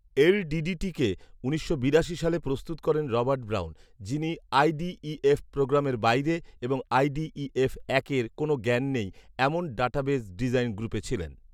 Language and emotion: Bengali, neutral